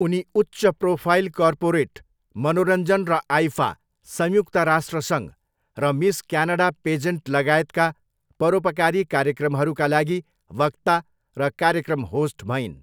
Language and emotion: Nepali, neutral